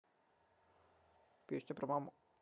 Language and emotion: Russian, neutral